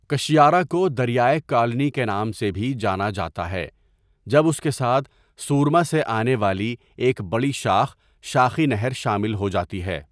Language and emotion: Urdu, neutral